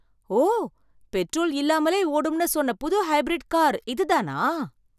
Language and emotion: Tamil, surprised